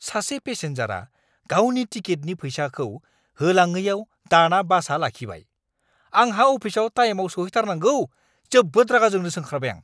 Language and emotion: Bodo, angry